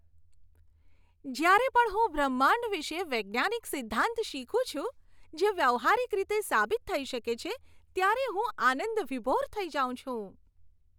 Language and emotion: Gujarati, happy